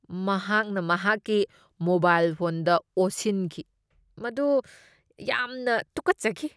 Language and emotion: Manipuri, disgusted